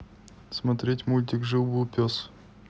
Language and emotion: Russian, neutral